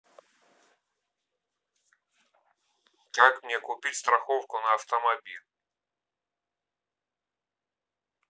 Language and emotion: Russian, neutral